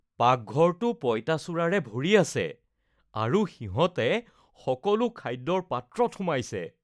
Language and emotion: Assamese, disgusted